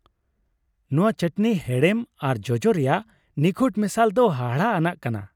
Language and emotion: Santali, happy